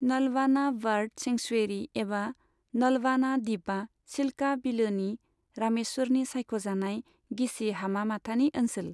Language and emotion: Bodo, neutral